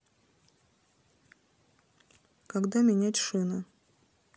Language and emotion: Russian, neutral